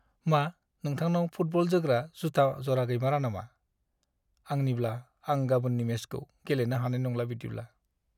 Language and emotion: Bodo, sad